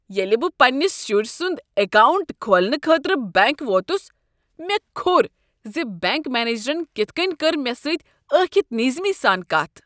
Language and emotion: Kashmiri, disgusted